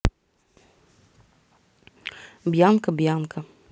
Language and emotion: Russian, neutral